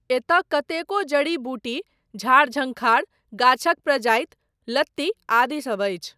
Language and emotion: Maithili, neutral